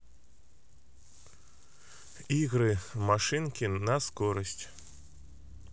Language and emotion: Russian, neutral